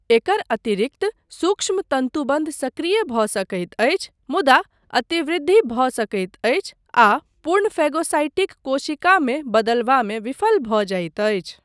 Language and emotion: Maithili, neutral